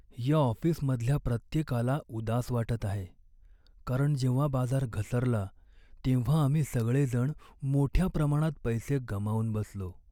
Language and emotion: Marathi, sad